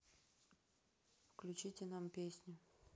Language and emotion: Russian, neutral